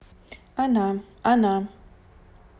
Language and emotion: Russian, neutral